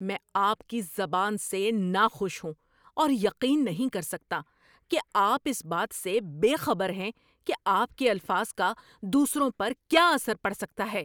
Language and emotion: Urdu, angry